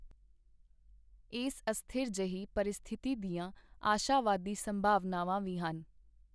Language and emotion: Punjabi, neutral